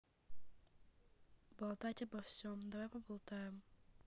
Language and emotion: Russian, neutral